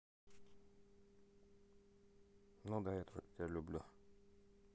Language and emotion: Russian, neutral